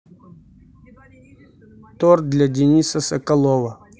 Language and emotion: Russian, neutral